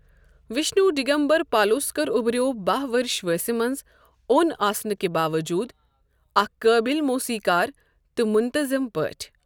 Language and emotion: Kashmiri, neutral